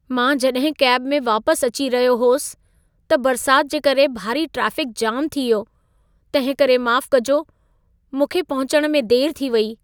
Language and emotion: Sindhi, sad